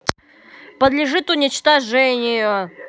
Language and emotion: Russian, angry